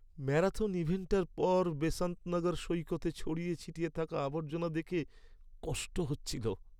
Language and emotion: Bengali, sad